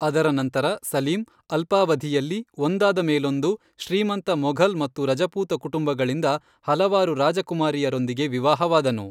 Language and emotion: Kannada, neutral